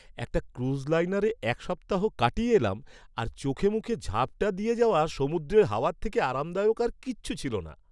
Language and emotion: Bengali, happy